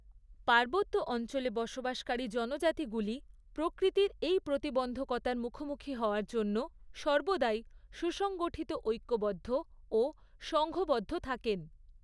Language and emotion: Bengali, neutral